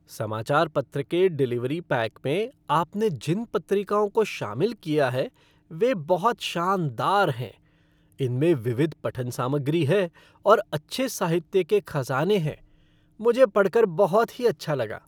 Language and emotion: Hindi, happy